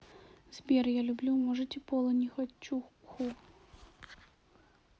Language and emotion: Russian, sad